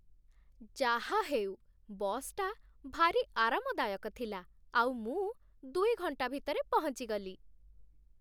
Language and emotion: Odia, happy